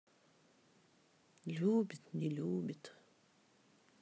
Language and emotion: Russian, sad